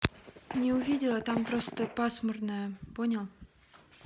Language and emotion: Russian, neutral